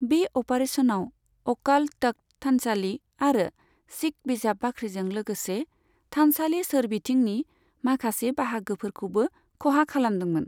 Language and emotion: Bodo, neutral